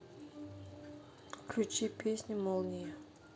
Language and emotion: Russian, neutral